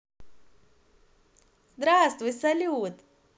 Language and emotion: Russian, positive